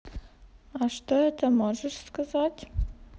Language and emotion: Russian, neutral